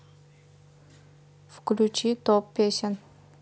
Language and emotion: Russian, neutral